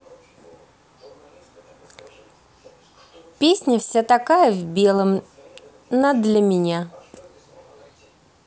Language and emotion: Russian, positive